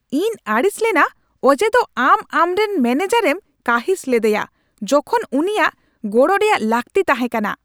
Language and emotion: Santali, angry